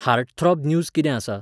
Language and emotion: Goan Konkani, neutral